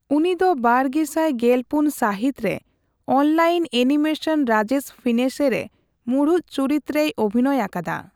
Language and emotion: Santali, neutral